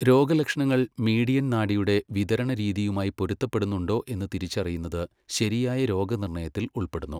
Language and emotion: Malayalam, neutral